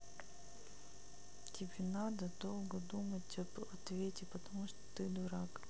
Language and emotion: Russian, neutral